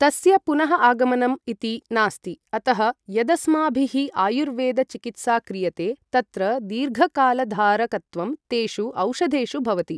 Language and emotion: Sanskrit, neutral